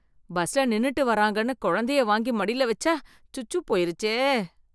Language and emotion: Tamil, disgusted